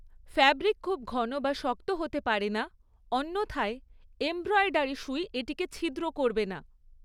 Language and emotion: Bengali, neutral